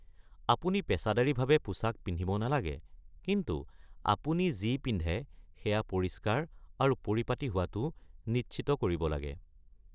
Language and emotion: Assamese, neutral